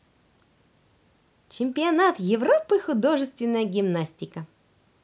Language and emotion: Russian, positive